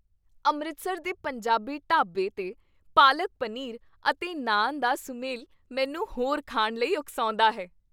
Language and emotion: Punjabi, happy